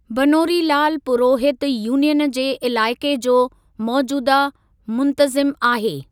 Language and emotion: Sindhi, neutral